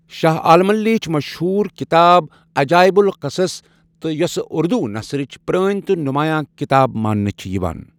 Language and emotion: Kashmiri, neutral